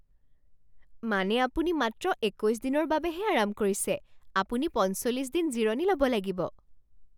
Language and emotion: Assamese, surprised